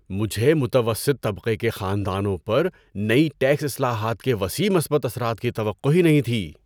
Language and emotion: Urdu, surprised